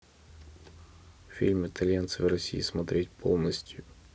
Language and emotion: Russian, neutral